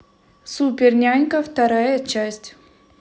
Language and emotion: Russian, neutral